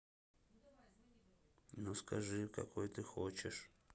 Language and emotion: Russian, sad